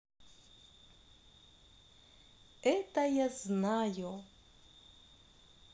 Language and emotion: Russian, positive